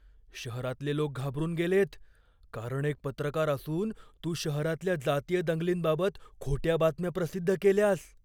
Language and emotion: Marathi, fearful